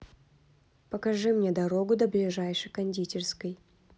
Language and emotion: Russian, neutral